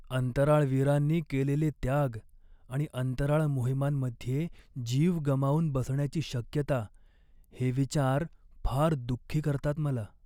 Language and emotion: Marathi, sad